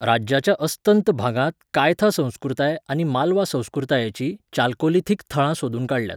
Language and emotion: Goan Konkani, neutral